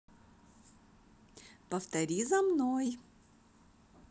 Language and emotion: Russian, positive